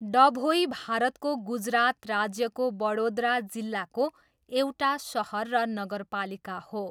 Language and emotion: Nepali, neutral